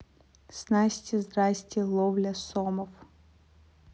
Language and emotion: Russian, neutral